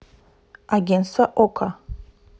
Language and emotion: Russian, neutral